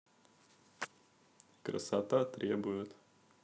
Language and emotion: Russian, neutral